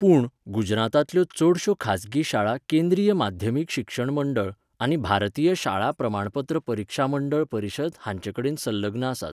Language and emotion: Goan Konkani, neutral